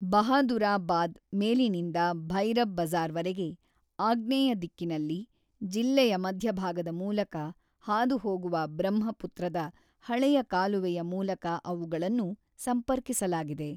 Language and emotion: Kannada, neutral